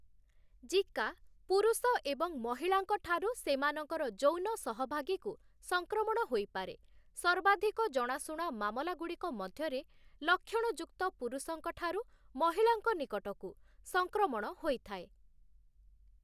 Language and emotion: Odia, neutral